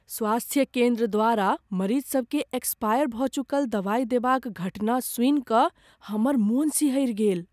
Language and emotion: Maithili, fearful